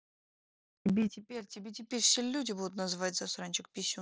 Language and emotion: Russian, angry